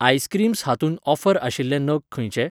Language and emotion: Goan Konkani, neutral